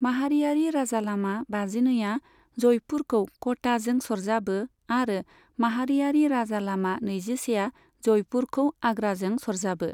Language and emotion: Bodo, neutral